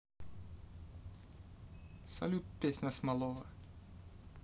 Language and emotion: Russian, neutral